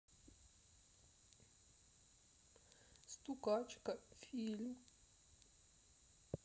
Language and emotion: Russian, sad